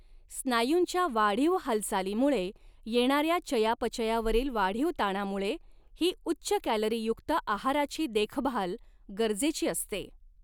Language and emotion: Marathi, neutral